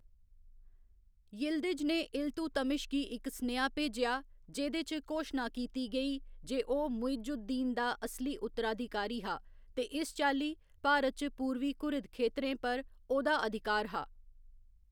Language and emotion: Dogri, neutral